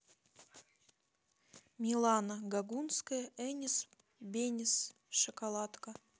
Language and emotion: Russian, neutral